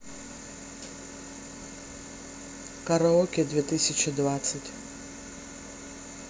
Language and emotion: Russian, neutral